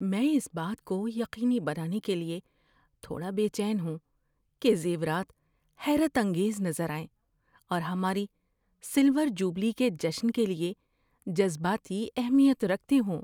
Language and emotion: Urdu, fearful